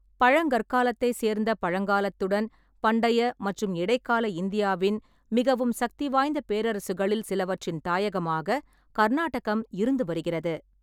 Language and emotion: Tamil, neutral